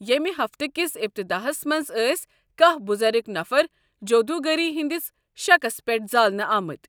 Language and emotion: Kashmiri, neutral